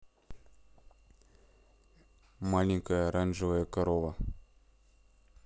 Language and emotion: Russian, neutral